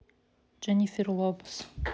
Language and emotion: Russian, neutral